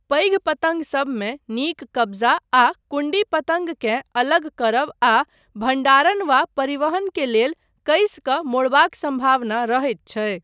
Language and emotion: Maithili, neutral